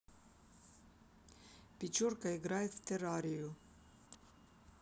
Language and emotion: Russian, neutral